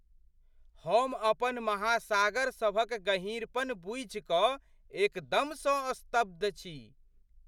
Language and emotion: Maithili, surprised